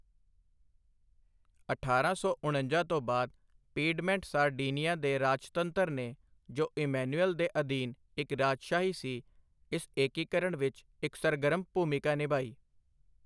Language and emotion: Punjabi, neutral